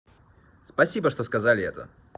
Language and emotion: Russian, positive